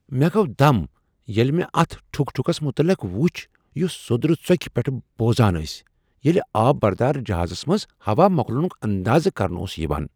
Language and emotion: Kashmiri, surprised